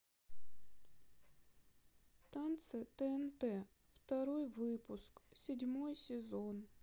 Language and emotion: Russian, sad